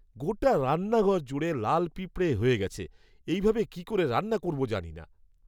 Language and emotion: Bengali, disgusted